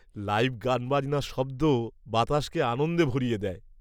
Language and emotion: Bengali, happy